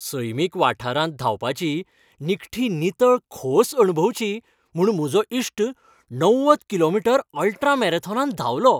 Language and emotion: Goan Konkani, happy